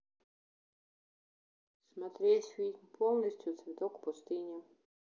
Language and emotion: Russian, neutral